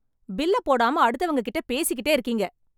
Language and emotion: Tamil, angry